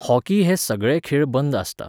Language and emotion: Goan Konkani, neutral